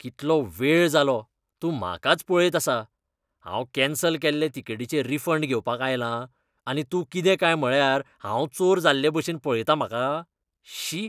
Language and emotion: Goan Konkani, disgusted